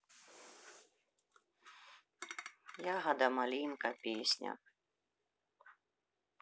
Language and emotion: Russian, neutral